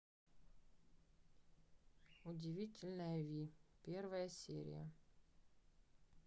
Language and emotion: Russian, neutral